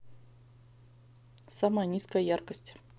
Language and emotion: Russian, neutral